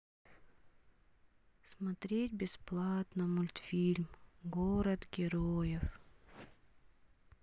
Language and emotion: Russian, sad